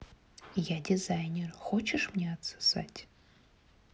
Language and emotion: Russian, neutral